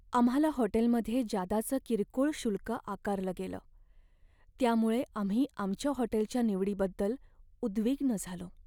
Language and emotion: Marathi, sad